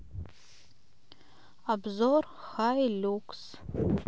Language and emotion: Russian, neutral